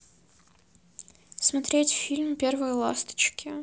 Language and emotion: Russian, neutral